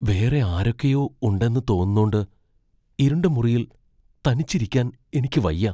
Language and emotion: Malayalam, fearful